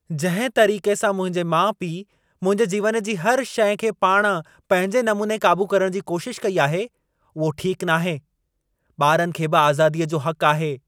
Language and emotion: Sindhi, angry